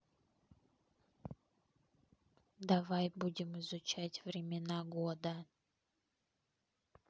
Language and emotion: Russian, neutral